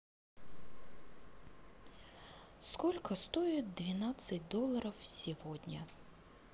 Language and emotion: Russian, sad